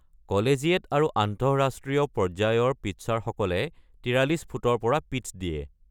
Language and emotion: Assamese, neutral